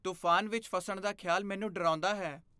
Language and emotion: Punjabi, fearful